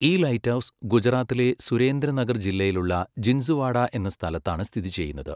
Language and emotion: Malayalam, neutral